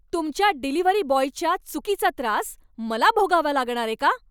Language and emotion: Marathi, angry